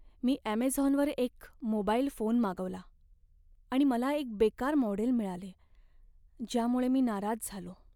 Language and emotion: Marathi, sad